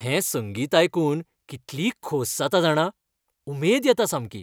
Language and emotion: Goan Konkani, happy